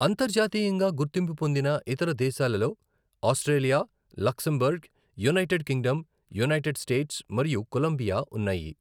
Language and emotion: Telugu, neutral